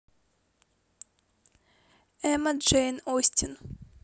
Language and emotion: Russian, neutral